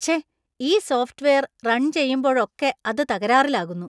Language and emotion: Malayalam, disgusted